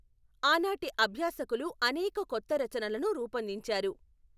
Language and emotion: Telugu, neutral